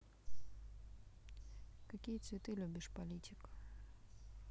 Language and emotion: Russian, neutral